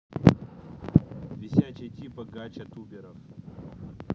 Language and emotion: Russian, neutral